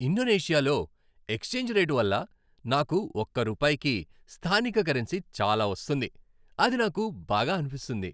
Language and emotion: Telugu, happy